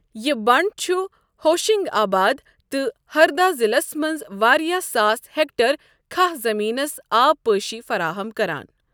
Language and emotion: Kashmiri, neutral